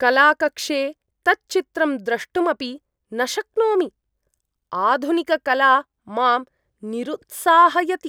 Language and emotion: Sanskrit, disgusted